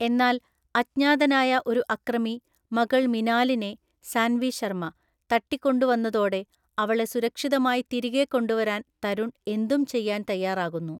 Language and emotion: Malayalam, neutral